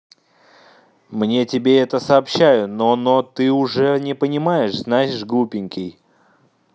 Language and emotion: Russian, neutral